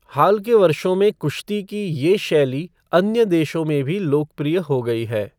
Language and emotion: Hindi, neutral